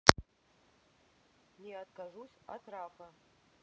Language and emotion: Russian, neutral